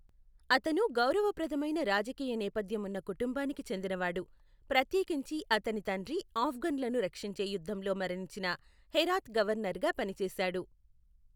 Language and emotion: Telugu, neutral